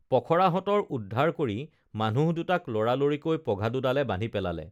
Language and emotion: Assamese, neutral